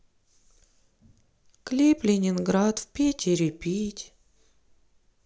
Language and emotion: Russian, sad